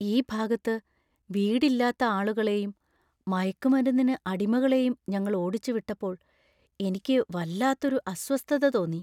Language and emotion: Malayalam, fearful